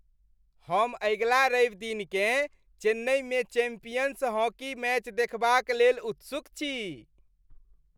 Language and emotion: Maithili, happy